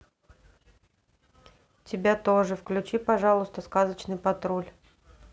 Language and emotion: Russian, neutral